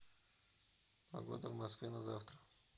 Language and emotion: Russian, neutral